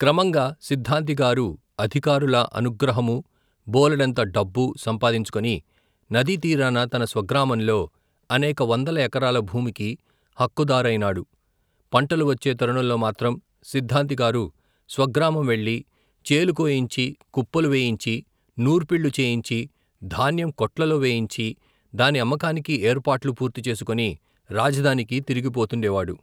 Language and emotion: Telugu, neutral